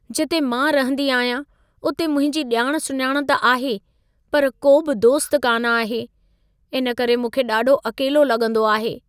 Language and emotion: Sindhi, sad